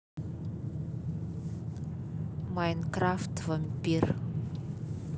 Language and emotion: Russian, neutral